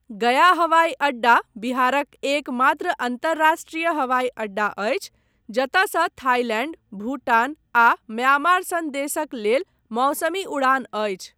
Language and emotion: Maithili, neutral